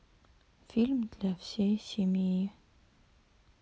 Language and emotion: Russian, sad